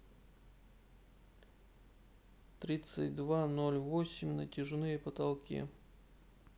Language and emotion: Russian, neutral